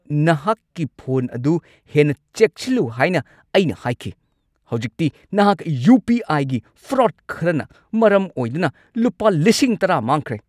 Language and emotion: Manipuri, angry